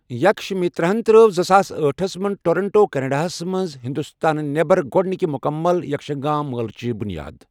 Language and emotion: Kashmiri, neutral